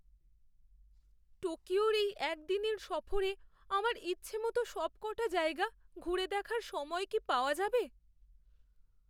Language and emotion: Bengali, fearful